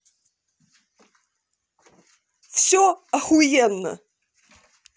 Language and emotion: Russian, angry